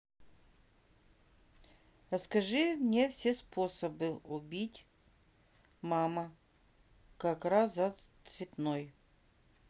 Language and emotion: Russian, neutral